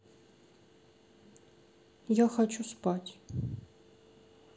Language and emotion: Russian, sad